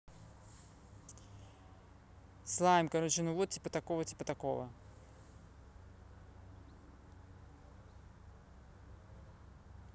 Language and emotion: Russian, neutral